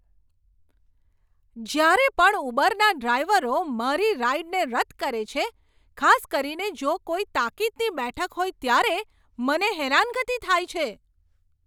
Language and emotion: Gujarati, angry